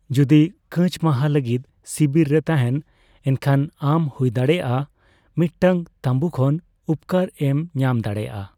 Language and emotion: Santali, neutral